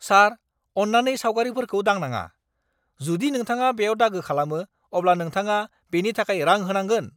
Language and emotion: Bodo, angry